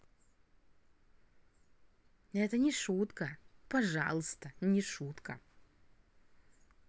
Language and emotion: Russian, positive